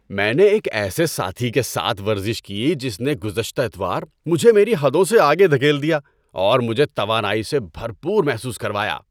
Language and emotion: Urdu, happy